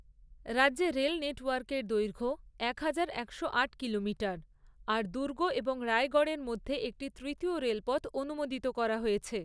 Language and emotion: Bengali, neutral